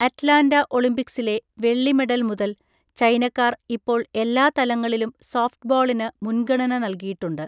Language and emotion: Malayalam, neutral